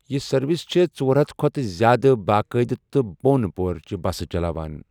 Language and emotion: Kashmiri, neutral